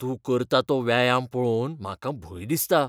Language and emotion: Goan Konkani, fearful